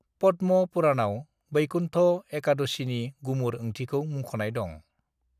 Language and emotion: Bodo, neutral